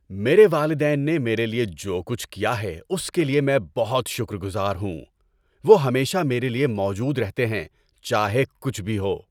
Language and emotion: Urdu, happy